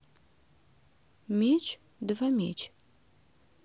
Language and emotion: Russian, neutral